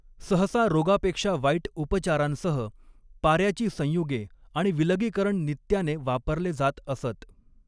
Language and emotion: Marathi, neutral